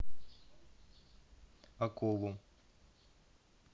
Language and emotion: Russian, neutral